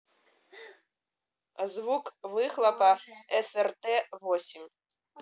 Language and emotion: Russian, neutral